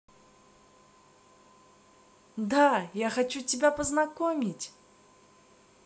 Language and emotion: Russian, positive